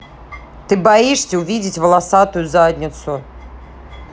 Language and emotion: Russian, angry